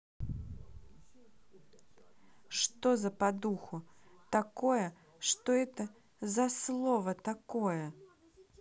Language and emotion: Russian, angry